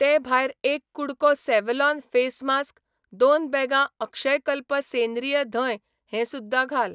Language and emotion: Goan Konkani, neutral